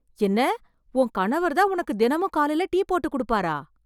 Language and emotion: Tamil, surprised